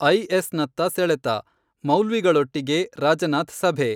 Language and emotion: Kannada, neutral